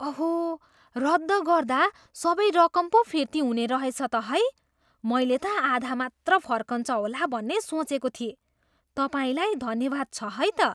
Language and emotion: Nepali, surprised